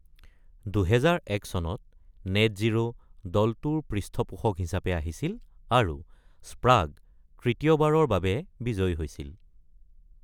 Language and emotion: Assamese, neutral